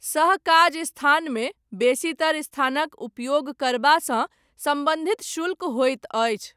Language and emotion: Maithili, neutral